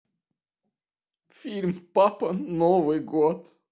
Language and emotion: Russian, sad